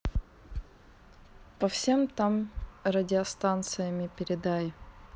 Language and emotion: Russian, neutral